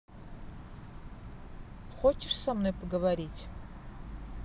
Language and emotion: Russian, neutral